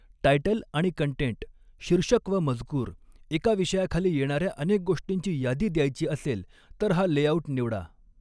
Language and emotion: Marathi, neutral